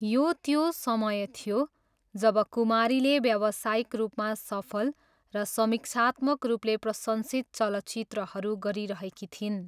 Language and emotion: Nepali, neutral